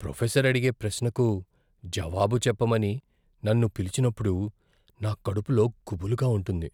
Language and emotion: Telugu, fearful